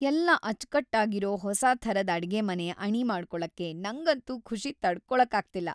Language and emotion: Kannada, happy